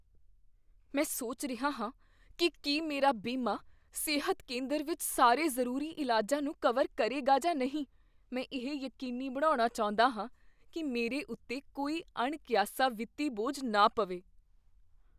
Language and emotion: Punjabi, fearful